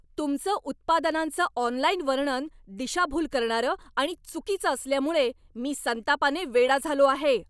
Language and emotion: Marathi, angry